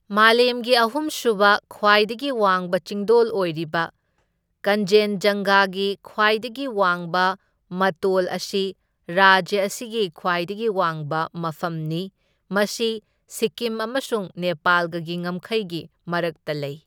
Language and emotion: Manipuri, neutral